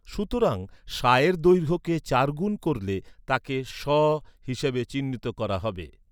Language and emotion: Bengali, neutral